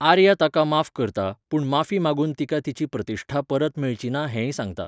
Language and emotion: Goan Konkani, neutral